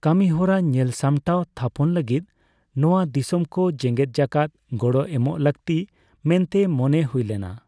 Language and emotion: Santali, neutral